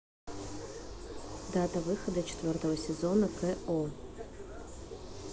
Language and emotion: Russian, neutral